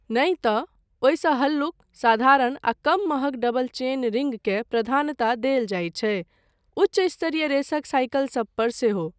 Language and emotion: Maithili, neutral